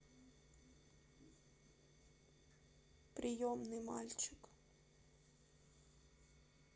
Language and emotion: Russian, sad